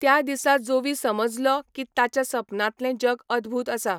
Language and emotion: Goan Konkani, neutral